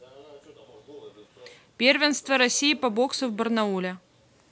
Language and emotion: Russian, neutral